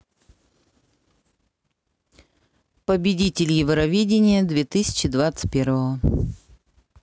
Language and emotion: Russian, neutral